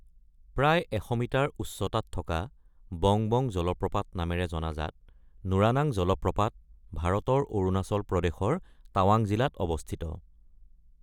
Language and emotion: Assamese, neutral